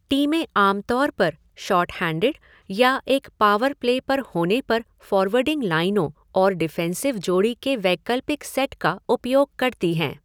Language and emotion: Hindi, neutral